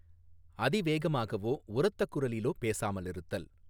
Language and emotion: Tamil, neutral